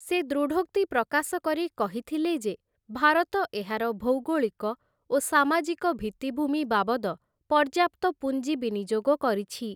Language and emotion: Odia, neutral